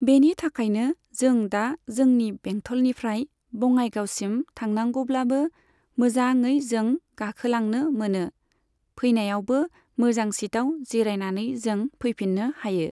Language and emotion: Bodo, neutral